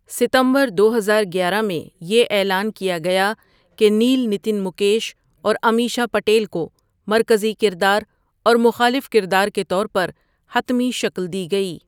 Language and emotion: Urdu, neutral